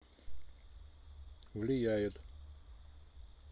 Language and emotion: Russian, neutral